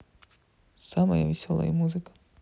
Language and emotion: Russian, sad